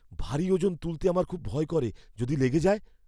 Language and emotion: Bengali, fearful